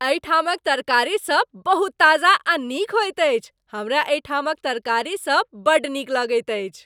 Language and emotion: Maithili, happy